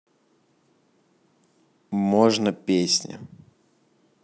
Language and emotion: Russian, neutral